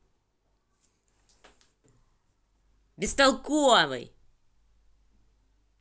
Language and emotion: Russian, angry